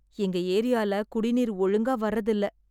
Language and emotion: Tamil, sad